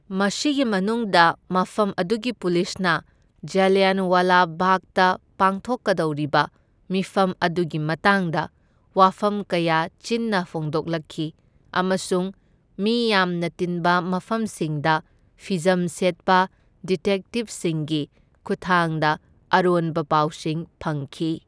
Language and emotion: Manipuri, neutral